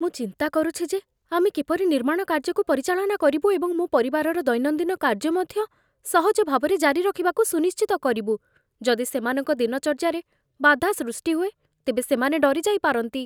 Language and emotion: Odia, fearful